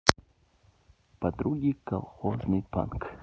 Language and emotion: Russian, neutral